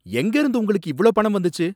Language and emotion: Tamil, angry